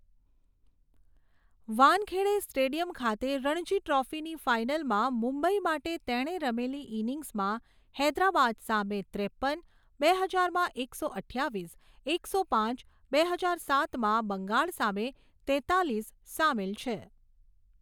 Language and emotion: Gujarati, neutral